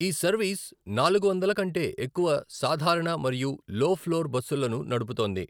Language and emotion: Telugu, neutral